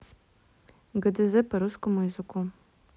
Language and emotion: Russian, neutral